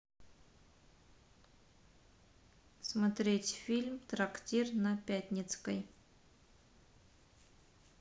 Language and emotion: Russian, neutral